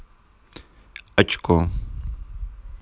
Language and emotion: Russian, neutral